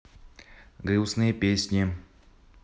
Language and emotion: Russian, neutral